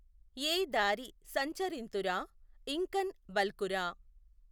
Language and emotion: Telugu, neutral